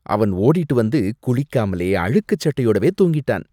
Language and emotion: Tamil, disgusted